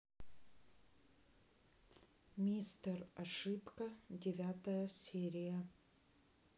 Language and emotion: Russian, neutral